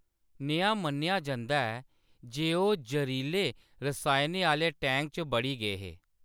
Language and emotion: Dogri, neutral